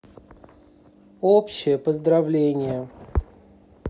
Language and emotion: Russian, neutral